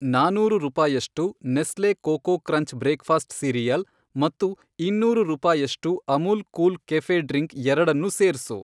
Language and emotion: Kannada, neutral